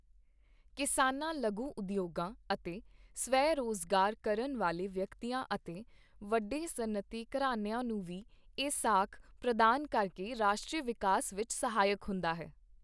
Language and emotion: Punjabi, neutral